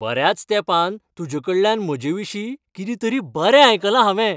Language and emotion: Goan Konkani, happy